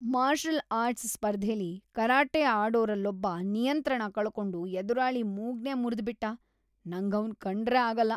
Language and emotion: Kannada, disgusted